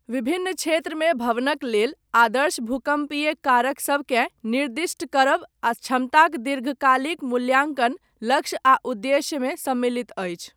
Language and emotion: Maithili, neutral